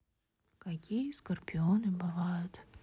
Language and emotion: Russian, sad